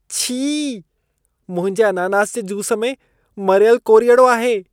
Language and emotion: Sindhi, disgusted